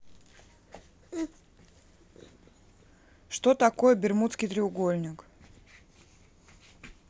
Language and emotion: Russian, neutral